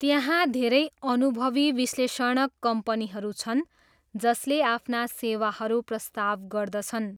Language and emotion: Nepali, neutral